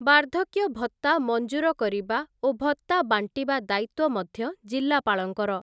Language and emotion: Odia, neutral